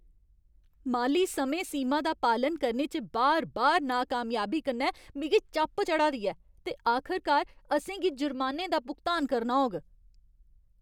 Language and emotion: Dogri, angry